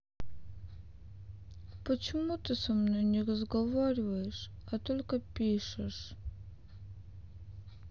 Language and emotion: Russian, sad